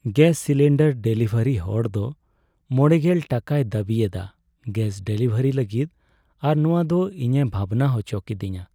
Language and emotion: Santali, sad